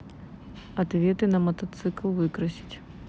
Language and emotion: Russian, neutral